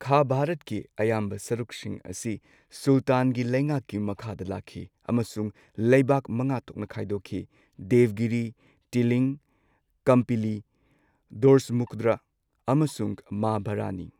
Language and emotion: Manipuri, neutral